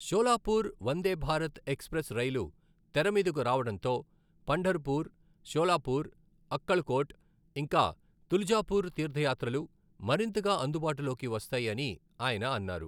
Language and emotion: Telugu, neutral